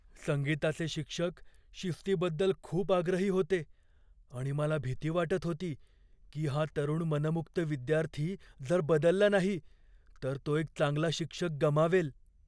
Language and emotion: Marathi, fearful